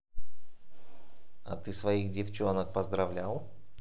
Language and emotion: Russian, neutral